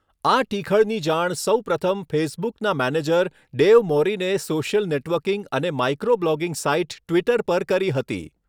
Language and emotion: Gujarati, neutral